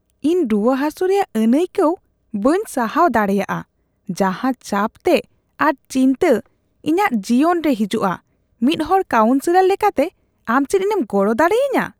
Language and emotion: Santali, disgusted